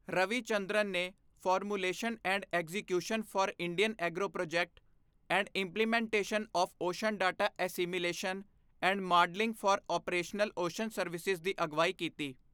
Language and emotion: Punjabi, neutral